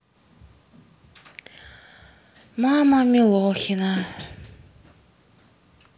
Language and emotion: Russian, sad